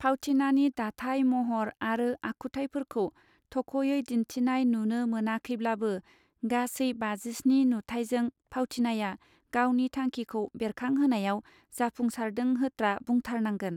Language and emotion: Bodo, neutral